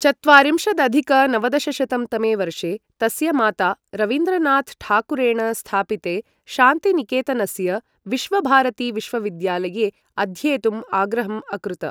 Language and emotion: Sanskrit, neutral